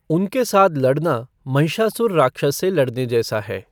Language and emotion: Hindi, neutral